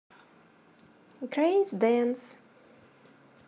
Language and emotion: Russian, positive